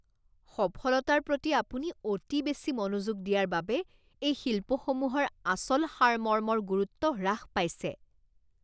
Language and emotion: Assamese, disgusted